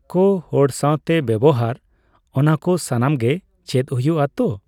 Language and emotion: Santali, neutral